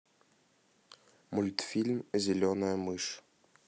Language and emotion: Russian, neutral